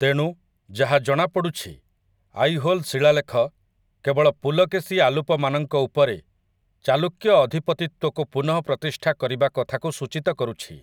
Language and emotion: Odia, neutral